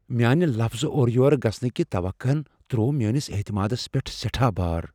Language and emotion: Kashmiri, fearful